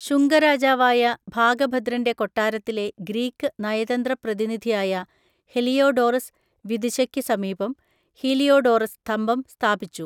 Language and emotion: Malayalam, neutral